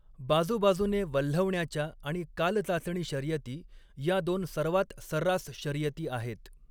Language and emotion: Marathi, neutral